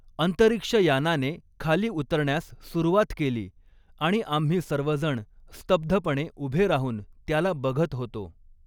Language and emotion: Marathi, neutral